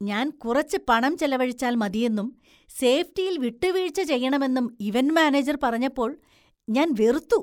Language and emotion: Malayalam, disgusted